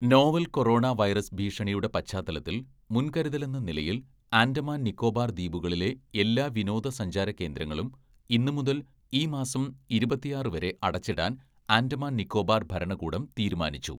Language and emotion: Malayalam, neutral